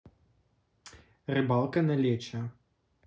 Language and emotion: Russian, neutral